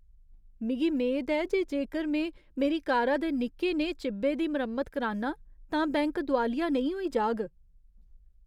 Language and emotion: Dogri, fearful